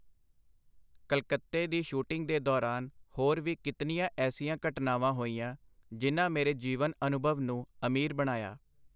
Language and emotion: Punjabi, neutral